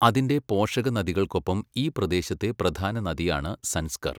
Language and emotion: Malayalam, neutral